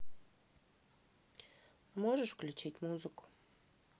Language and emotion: Russian, neutral